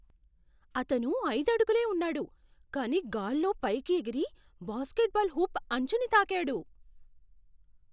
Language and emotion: Telugu, surprised